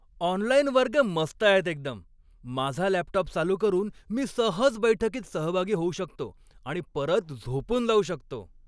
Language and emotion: Marathi, happy